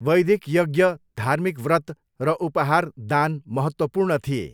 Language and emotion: Nepali, neutral